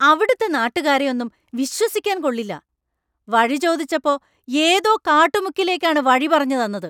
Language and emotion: Malayalam, angry